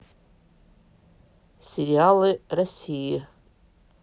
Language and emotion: Russian, neutral